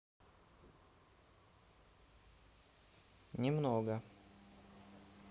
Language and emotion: Russian, neutral